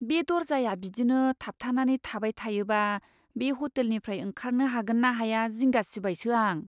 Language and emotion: Bodo, fearful